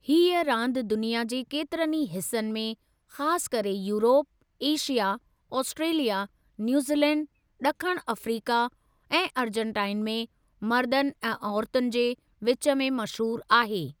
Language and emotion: Sindhi, neutral